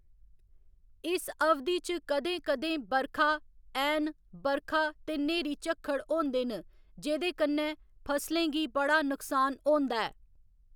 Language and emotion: Dogri, neutral